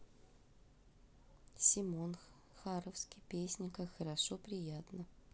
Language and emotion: Russian, neutral